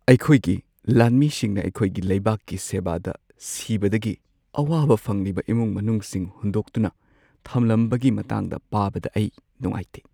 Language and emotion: Manipuri, sad